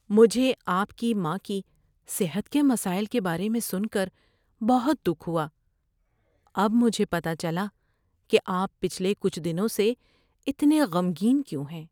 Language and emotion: Urdu, sad